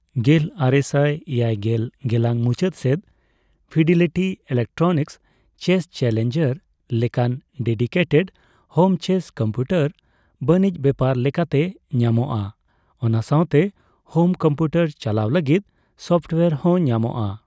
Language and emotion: Santali, neutral